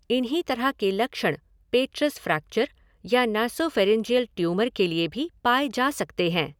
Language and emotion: Hindi, neutral